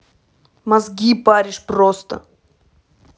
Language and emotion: Russian, angry